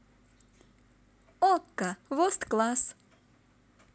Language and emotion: Russian, positive